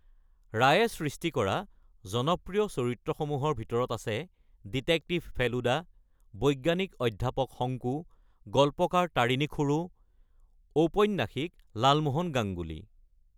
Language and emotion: Assamese, neutral